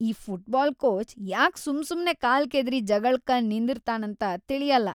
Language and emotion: Kannada, disgusted